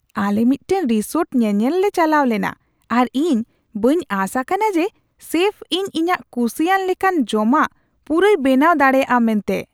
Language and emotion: Santali, surprised